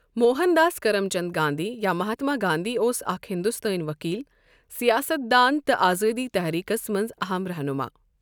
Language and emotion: Kashmiri, neutral